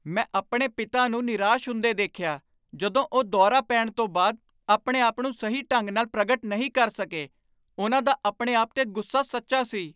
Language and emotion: Punjabi, angry